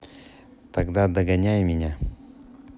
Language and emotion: Russian, neutral